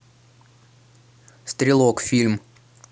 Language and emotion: Russian, neutral